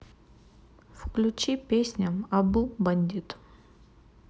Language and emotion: Russian, neutral